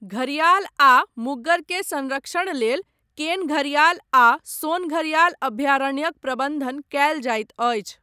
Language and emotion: Maithili, neutral